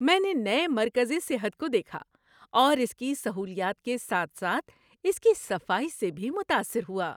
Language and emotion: Urdu, happy